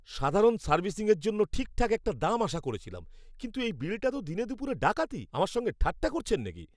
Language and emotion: Bengali, angry